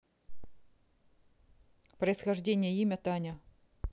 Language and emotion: Russian, neutral